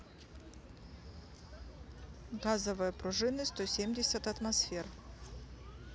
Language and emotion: Russian, neutral